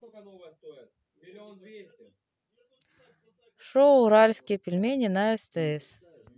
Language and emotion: Russian, neutral